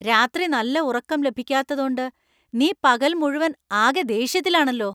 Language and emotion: Malayalam, angry